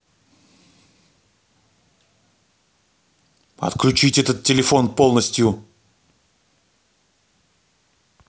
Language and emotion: Russian, angry